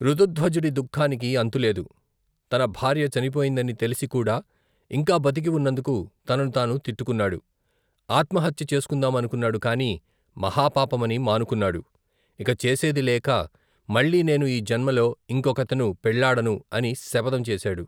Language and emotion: Telugu, neutral